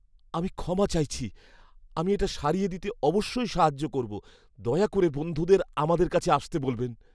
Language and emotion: Bengali, fearful